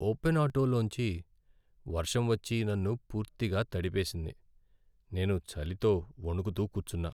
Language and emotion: Telugu, sad